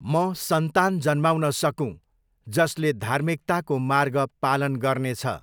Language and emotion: Nepali, neutral